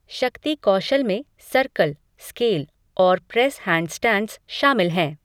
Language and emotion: Hindi, neutral